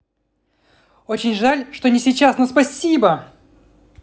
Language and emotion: Russian, positive